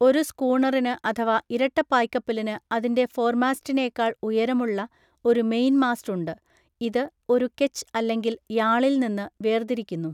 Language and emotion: Malayalam, neutral